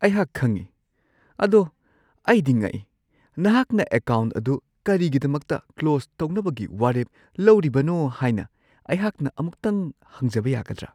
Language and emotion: Manipuri, surprised